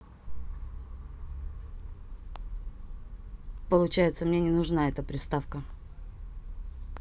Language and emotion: Russian, neutral